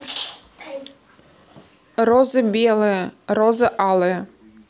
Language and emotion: Russian, neutral